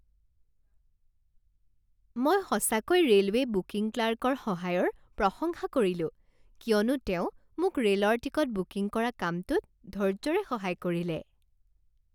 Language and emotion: Assamese, happy